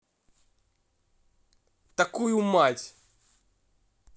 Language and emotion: Russian, angry